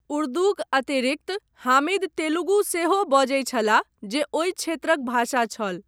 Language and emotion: Maithili, neutral